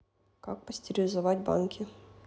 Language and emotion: Russian, neutral